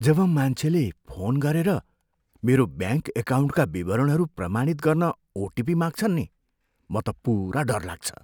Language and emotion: Nepali, fearful